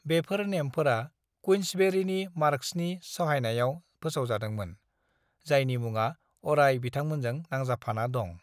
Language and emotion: Bodo, neutral